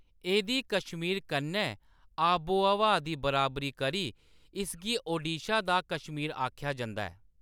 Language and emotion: Dogri, neutral